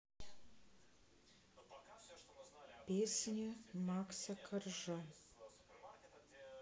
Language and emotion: Russian, sad